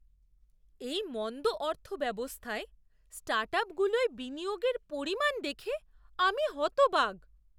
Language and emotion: Bengali, surprised